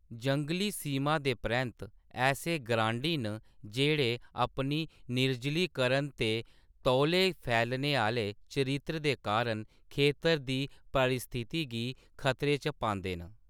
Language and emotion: Dogri, neutral